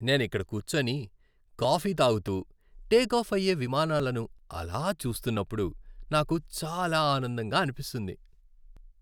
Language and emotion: Telugu, happy